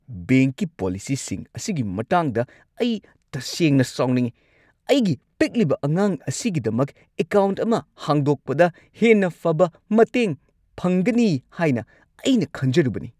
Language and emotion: Manipuri, angry